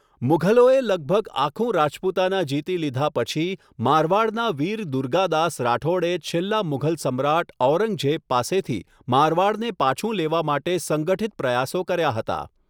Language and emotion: Gujarati, neutral